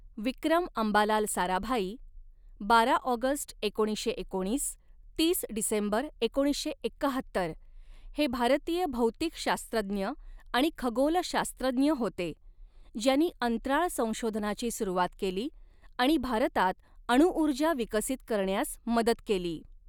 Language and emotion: Marathi, neutral